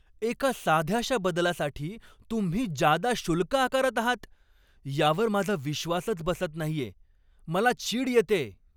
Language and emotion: Marathi, angry